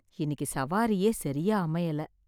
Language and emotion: Tamil, sad